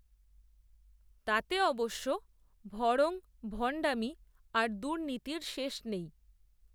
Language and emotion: Bengali, neutral